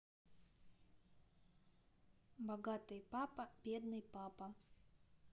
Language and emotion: Russian, neutral